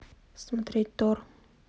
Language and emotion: Russian, neutral